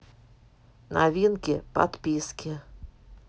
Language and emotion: Russian, neutral